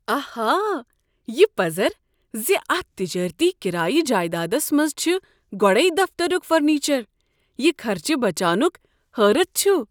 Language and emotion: Kashmiri, surprised